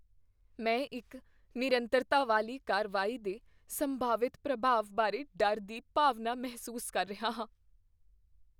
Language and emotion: Punjabi, fearful